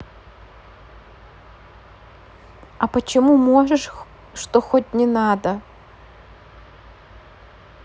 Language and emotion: Russian, neutral